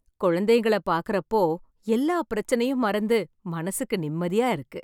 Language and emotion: Tamil, happy